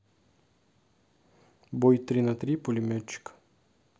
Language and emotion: Russian, neutral